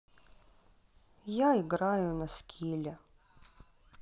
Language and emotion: Russian, sad